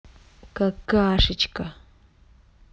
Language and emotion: Russian, angry